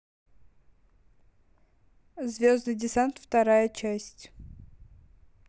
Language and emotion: Russian, neutral